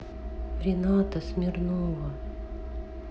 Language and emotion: Russian, sad